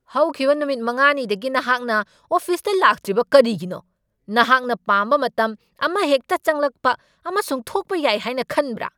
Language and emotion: Manipuri, angry